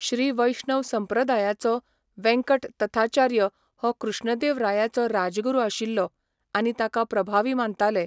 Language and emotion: Goan Konkani, neutral